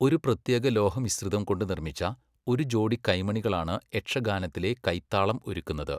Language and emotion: Malayalam, neutral